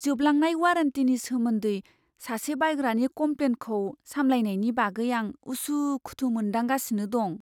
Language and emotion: Bodo, fearful